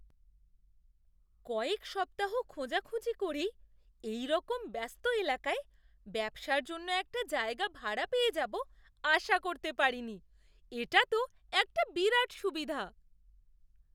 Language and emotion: Bengali, surprised